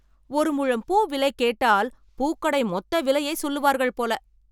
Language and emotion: Tamil, angry